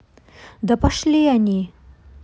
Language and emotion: Russian, angry